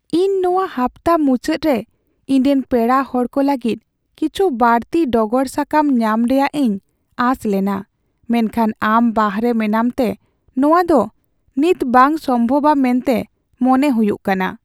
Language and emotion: Santali, sad